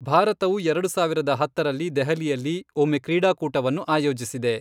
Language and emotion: Kannada, neutral